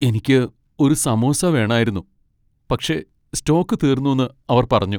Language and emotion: Malayalam, sad